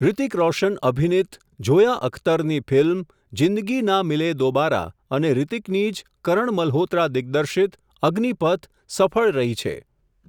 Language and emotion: Gujarati, neutral